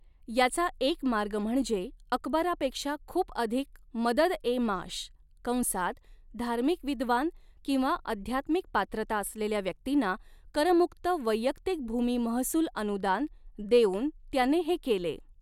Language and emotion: Marathi, neutral